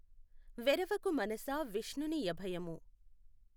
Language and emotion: Telugu, neutral